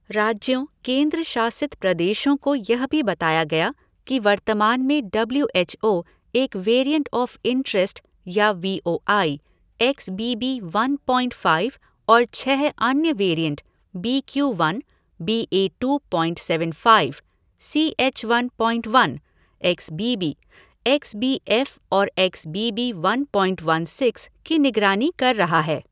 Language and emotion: Hindi, neutral